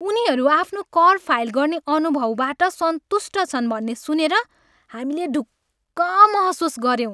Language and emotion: Nepali, happy